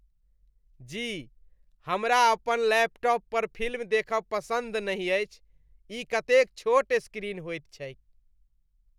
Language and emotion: Maithili, disgusted